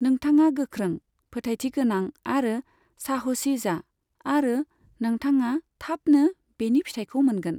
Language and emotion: Bodo, neutral